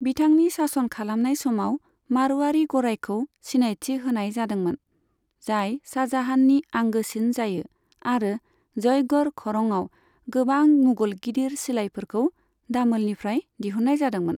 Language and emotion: Bodo, neutral